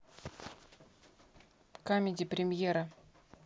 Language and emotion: Russian, neutral